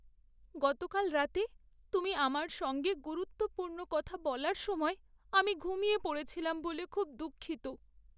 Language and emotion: Bengali, sad